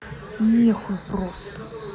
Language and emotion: Russian, angry